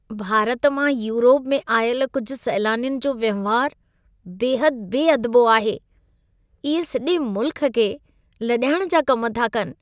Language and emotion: Sindhi, disgusted